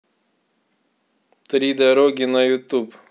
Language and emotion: Russian, neutral